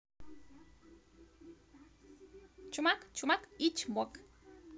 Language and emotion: Russian, positive